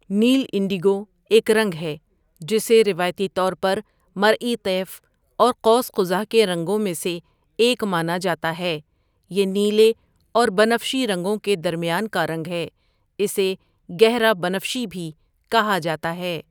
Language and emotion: Urdu, neutral